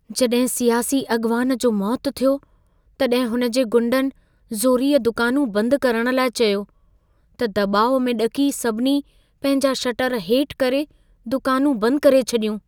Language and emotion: Sindhi, fearful